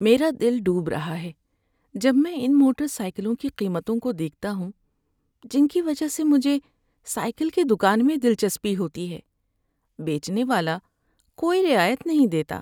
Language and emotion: Urdu, sad